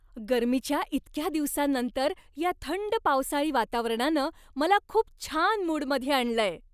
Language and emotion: Marathi, happy